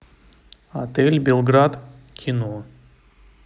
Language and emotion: Russian, neutral